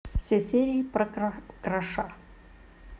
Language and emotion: Russian, neutral